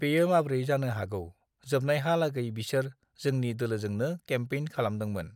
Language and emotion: Bodo, neutral